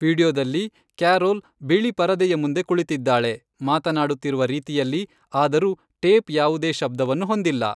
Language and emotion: Kannada, neutral